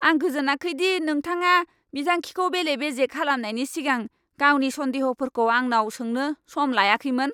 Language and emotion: Bodo, angry